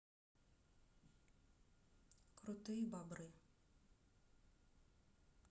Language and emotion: Russian, neutral